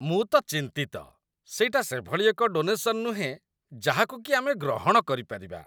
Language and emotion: Odia, disgusted